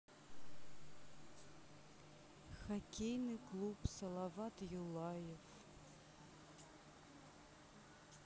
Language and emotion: Russian, sad